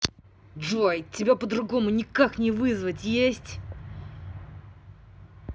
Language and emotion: Russian, angry